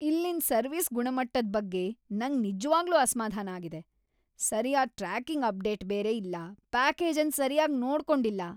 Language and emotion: Kannada, angry